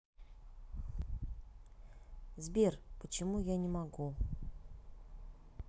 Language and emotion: Russian, neutral